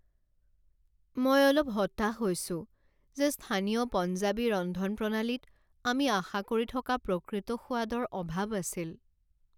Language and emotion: Assamese, sad